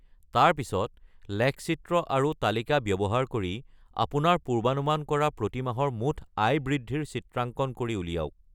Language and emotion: Assamese, neutral